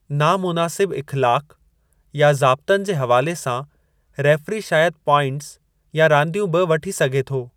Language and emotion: Sindhi, neutral